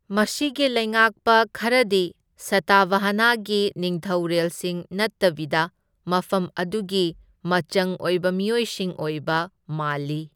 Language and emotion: Manipuri, neutral